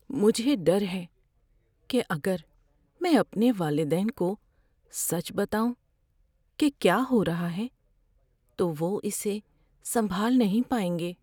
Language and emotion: Urdu, fearful